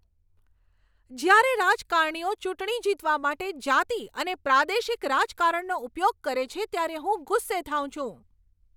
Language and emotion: Gujarati, angry